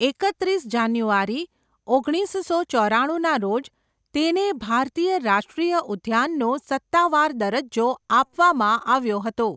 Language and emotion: Gujarati, neutral